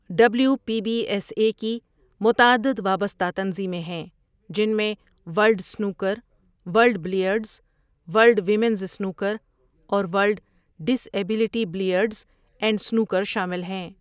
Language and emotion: Urdu, neutral